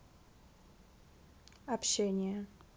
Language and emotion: Russian, neutral